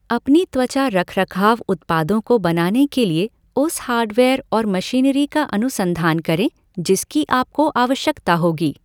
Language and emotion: Hindi, neutral